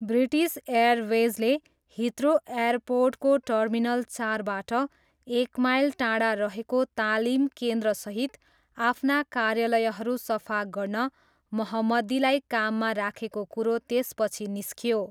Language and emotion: Nepali, neutral